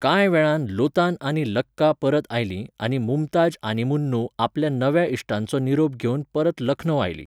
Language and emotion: Goan Konkani, neutral